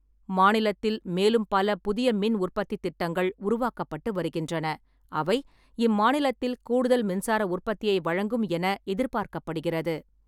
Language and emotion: Tamil, neutral